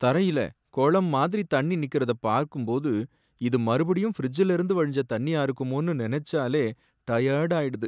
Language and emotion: Tamil, sad